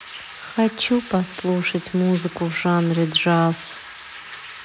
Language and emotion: Russian, sad